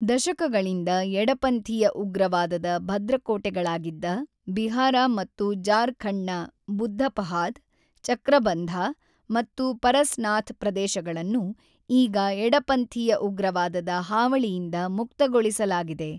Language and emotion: Kannada, neutral